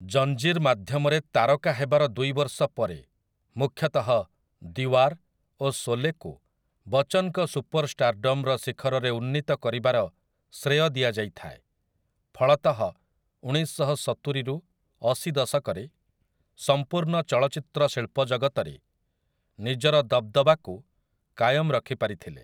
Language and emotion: Odia, neutral